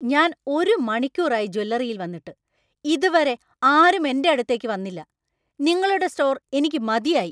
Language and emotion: Malayalam, angry